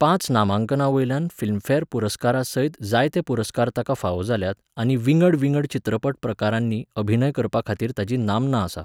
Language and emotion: Goan Konkani, neutral